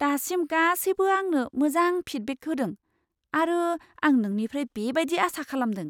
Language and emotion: Bodo, surprised